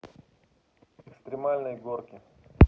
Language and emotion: Russian, neutral